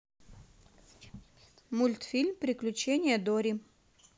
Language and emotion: Russian, neutral